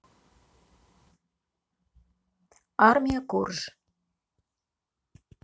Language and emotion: Russian, neutral